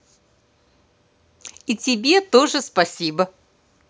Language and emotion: Russian, positive